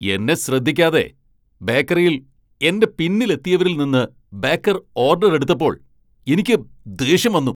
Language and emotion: Malayalam, angry